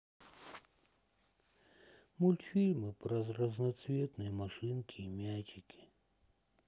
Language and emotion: Russian, sad